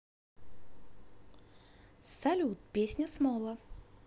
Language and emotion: Russian, positive